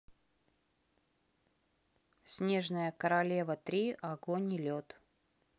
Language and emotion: Russian, neutral